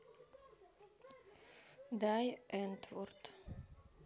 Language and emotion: Russian, neutral